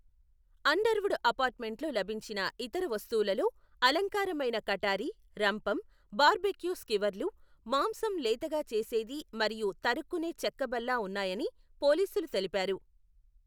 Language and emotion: Telugu, neutral